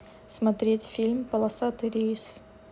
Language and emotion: Russian, neutral